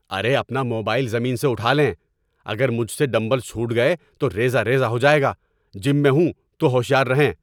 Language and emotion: Urdu, angry